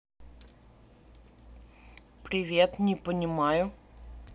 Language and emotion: Russian, neutral